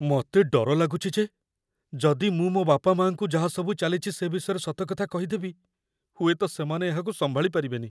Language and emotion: Odia, fearful